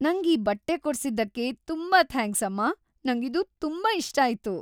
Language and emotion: Kannada, happy